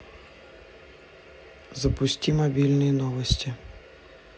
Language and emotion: Russian, neutral